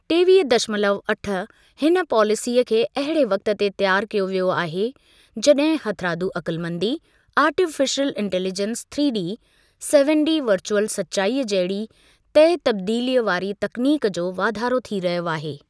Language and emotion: Sindhi, neutral